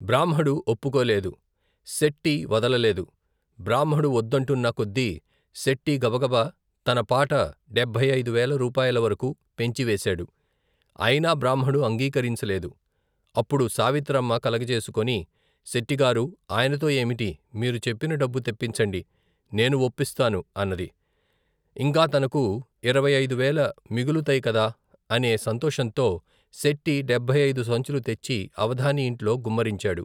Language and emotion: Telugu, neutral